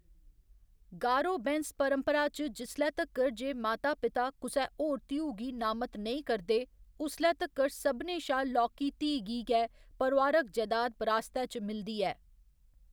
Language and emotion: Dogri, neutral